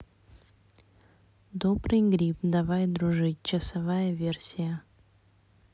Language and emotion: Russian, neutral